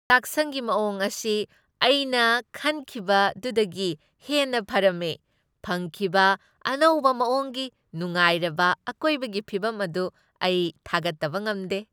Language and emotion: Manipuri, happy